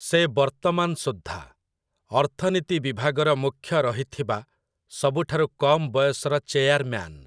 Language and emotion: Odia, neutral